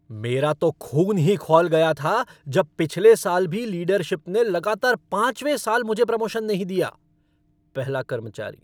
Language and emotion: Hindi, angry